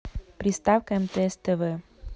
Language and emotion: Russian, neutral